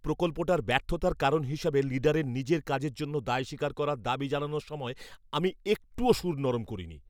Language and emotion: Bengali, angry